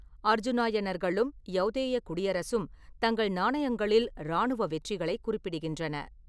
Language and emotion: Tamil, neutral